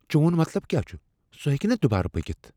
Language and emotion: Kashmiri, fearful